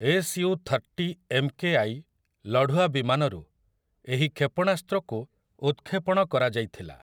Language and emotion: Odia, neutral